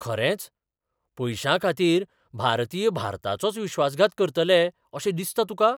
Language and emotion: Goan Konkani, surprised